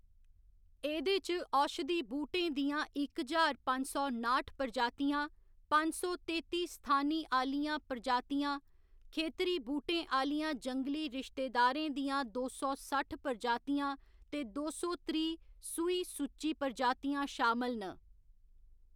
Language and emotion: Dogri, neutral